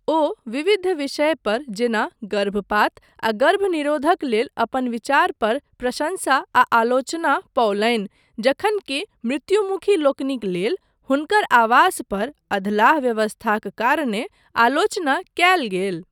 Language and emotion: Maithili, neutral